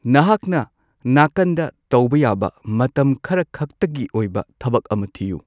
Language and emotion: Manipuri, neutral